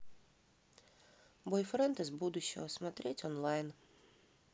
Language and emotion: Russian, neutral